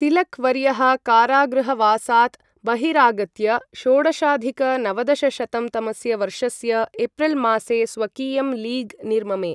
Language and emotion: Sanskrit, neutral